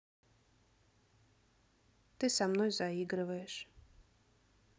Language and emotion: Russian, neutral